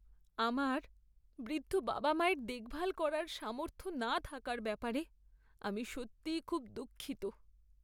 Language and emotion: Bengali, sad